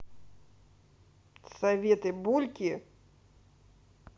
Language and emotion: Russian, neutral